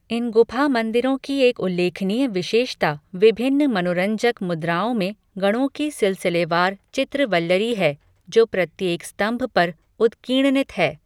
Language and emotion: Hindi, neutral